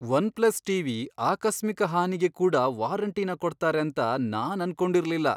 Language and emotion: Kannada, surprised